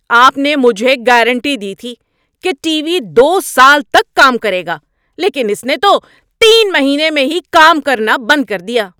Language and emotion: Urdu, angry